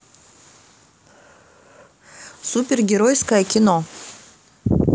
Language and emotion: Russian, neutral